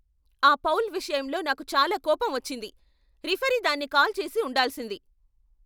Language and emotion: Telugu, angry